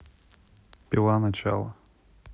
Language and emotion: Russian, neutral